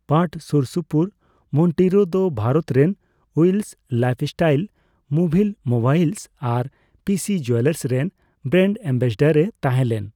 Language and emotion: Santali, neutral